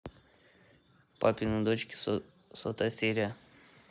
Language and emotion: Russian, neutral